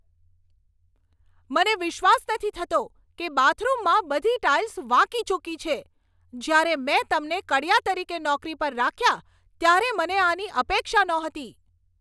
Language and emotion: Gujarati, angry